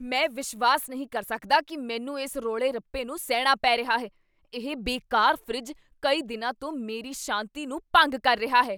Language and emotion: Punjabi, angry